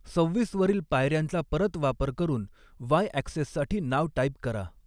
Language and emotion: Marathi, neutral